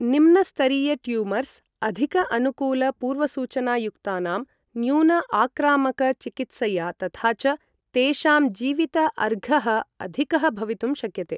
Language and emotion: Sanskrit, neutral